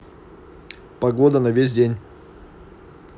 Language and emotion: Russian, neutral